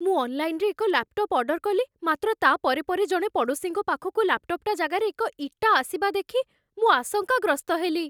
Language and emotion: Odia, fearful